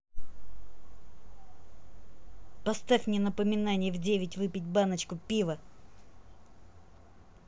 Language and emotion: Russian, angry